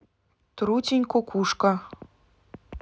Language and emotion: Russian, neutral